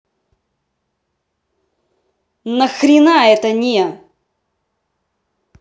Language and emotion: Russian, angry